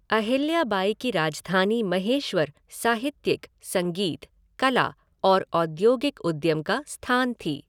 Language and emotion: Hindi, neutral